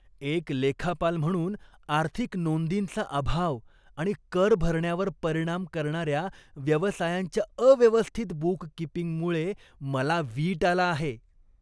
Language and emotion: Marathi, disgusted